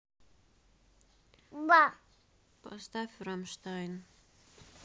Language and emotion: Russian, sad